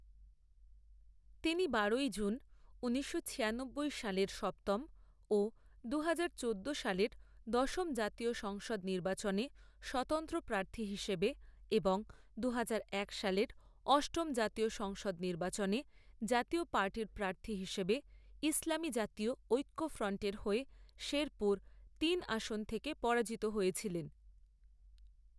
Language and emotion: Bengali, neutral